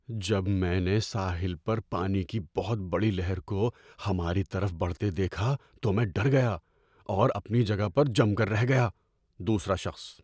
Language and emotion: Urdu, fearful